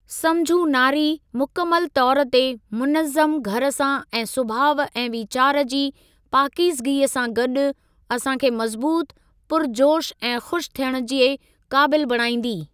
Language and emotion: Sindhi, neutral